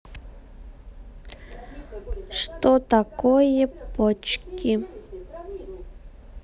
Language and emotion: Russian, neutral